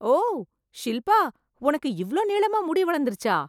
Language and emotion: Tamil, surprised